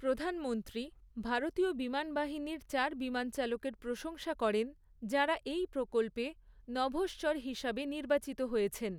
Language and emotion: Bengali, neutral